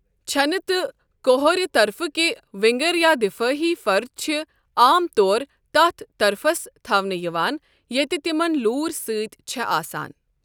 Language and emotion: Kashmiri, neutral